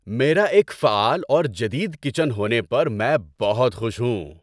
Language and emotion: Urdu, happy